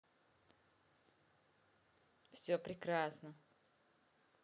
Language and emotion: Russian, neutral